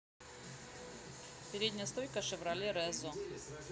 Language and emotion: Russian, neutral